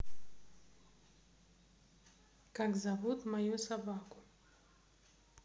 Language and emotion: Russian, neutral